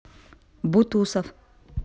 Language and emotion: Russian, neutral